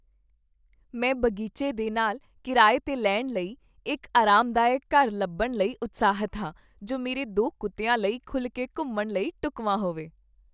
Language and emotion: Punjabi, happy